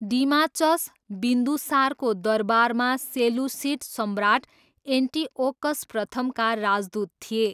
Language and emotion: Nepali, neutral